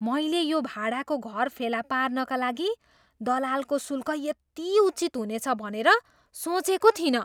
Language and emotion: Nepali, surprised